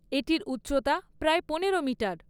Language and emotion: Bengali, neutral